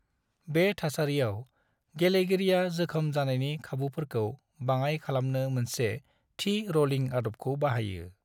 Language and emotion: Bodo, neutral